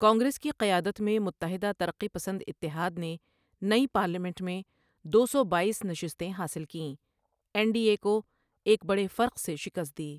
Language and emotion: Urdu, neutral